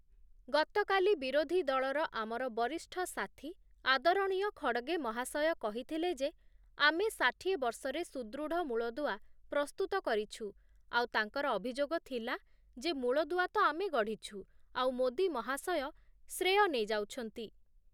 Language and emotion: Odia, neutral